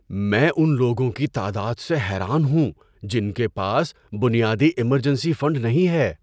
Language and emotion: Urdu, surprised